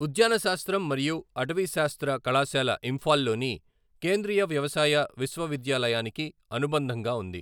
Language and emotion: Telugu, neutral